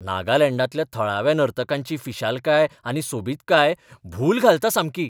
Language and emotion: Goan Konkani, surprised